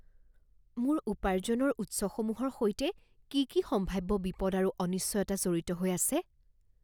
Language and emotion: Assamese, fearful